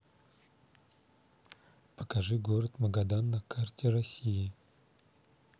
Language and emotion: Russian, neutral